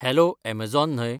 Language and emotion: Goan Konkani, neutral